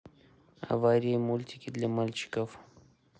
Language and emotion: Russian, neutral